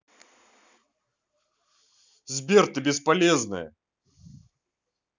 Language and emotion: Russian, angry